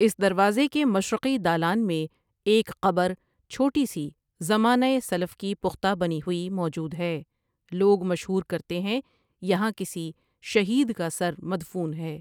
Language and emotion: Urdu, neutral